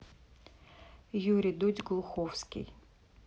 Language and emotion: Russian, neutral